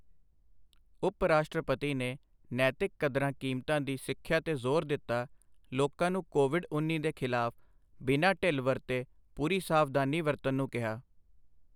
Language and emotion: Punjabi, neutral